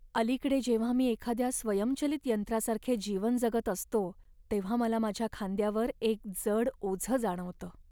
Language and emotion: Marathi, sad